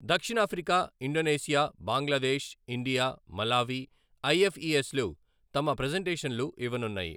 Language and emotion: Telugu, neutral